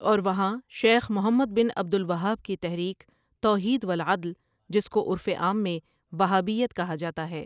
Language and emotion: Urdu, neutral